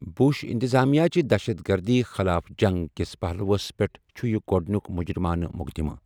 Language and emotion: Kashmiri, neutral